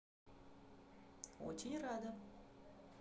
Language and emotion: Russian, positive